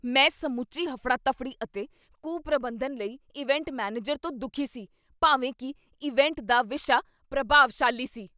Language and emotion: Punjabi, angry